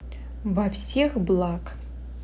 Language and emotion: Russian, neutral